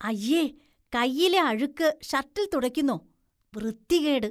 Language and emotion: Malayalam, disgusted